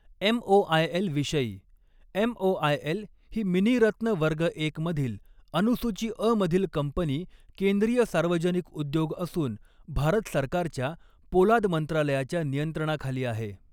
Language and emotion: Marathi, neutral